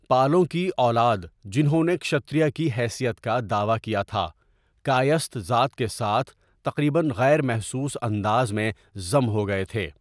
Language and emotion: Urdu, neutral